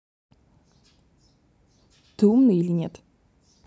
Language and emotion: Russian, neutral